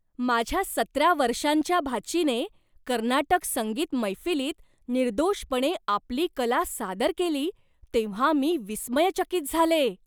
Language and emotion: Marathi, surprised